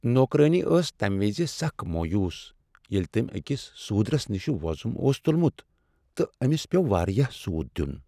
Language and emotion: Kashmiri, sad